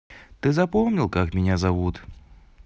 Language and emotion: Russian, positive